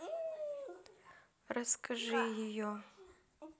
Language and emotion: Russian, neutral